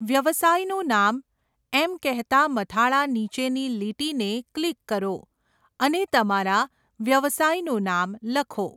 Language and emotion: Gujarati, neutral